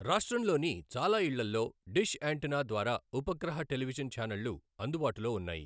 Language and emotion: Telugu, neutral